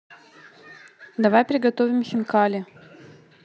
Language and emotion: Russian, neutral